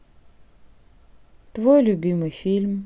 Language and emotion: Russian, neutral